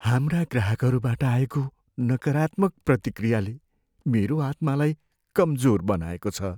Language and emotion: Nepali, sad